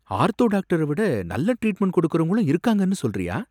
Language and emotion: Tamil, surprised